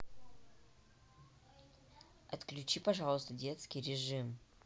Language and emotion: Russian, neutral